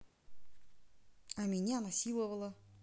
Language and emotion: Russian, neutral